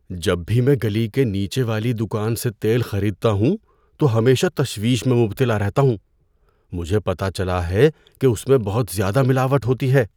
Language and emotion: Urdu, fearful